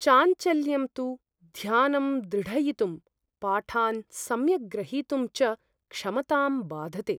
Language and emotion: Sanskrit, fearful